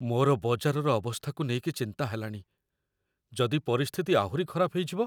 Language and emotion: Odia, fearful